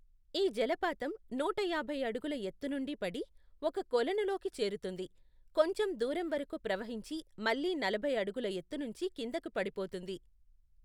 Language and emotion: Telugu, neutral